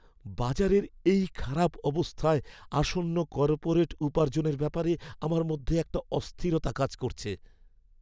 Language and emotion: Bengali, fearful